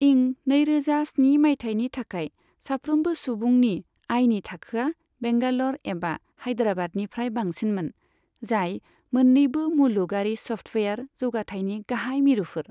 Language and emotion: Bodo, neutral